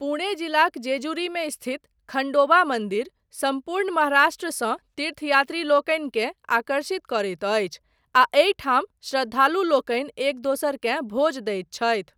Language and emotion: Maithili, neutral